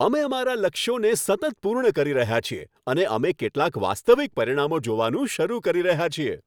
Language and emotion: Gujarati, happy